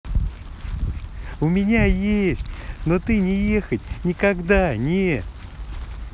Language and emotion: Russian, positive